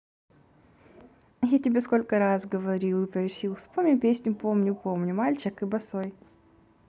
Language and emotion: Russian, positive